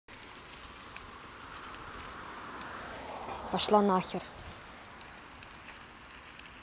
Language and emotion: Russian, angry